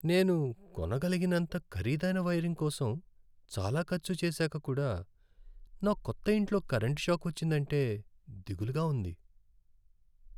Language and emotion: Telugu, sad